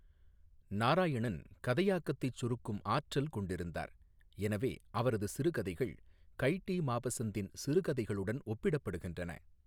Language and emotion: Tamil, neutral